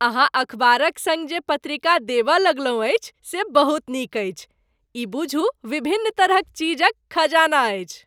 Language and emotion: Maithili, happy